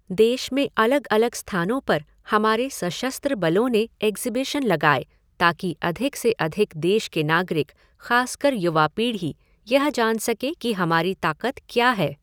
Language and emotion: Hindi, neutral